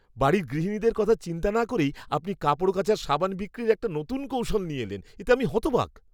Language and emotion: Bengali, disgusted